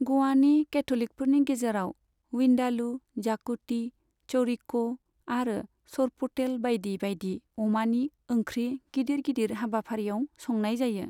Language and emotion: Bodo, neutral